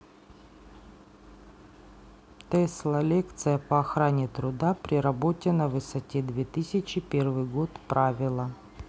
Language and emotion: Russian, neutral